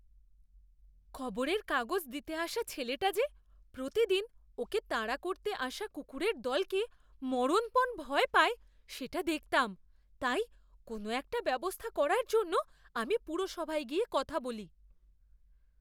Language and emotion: Bengali, fearful